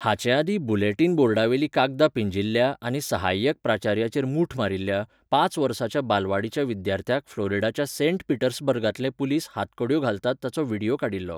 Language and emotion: Goan Konkani, neutral